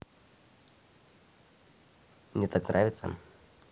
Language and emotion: Russian, neutral